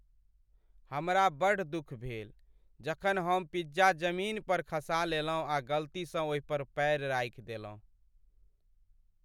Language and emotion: Maithili, sad